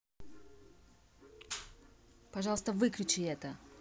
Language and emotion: Russian, angry